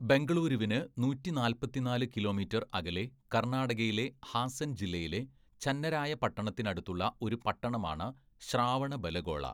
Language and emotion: Malayalam, neutral